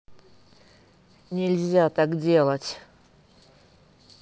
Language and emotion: Russian, angry